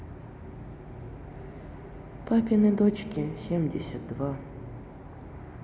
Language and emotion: Russian, neutral